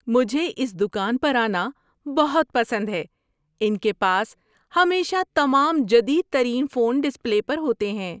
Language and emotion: Urdu, happy